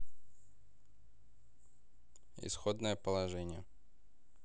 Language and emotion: Russian, neutral